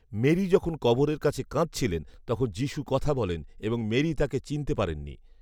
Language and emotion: Bengali, neutral